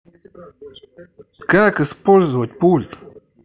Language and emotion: Russian, angry